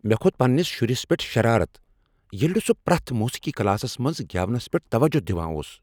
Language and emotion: Kashmiri, angry